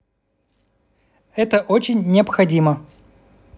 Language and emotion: Russian, neutral